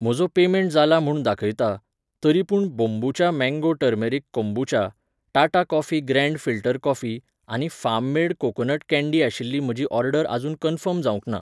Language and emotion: Goan Konkani, neutral